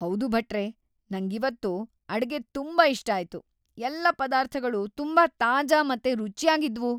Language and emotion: Kannada, happy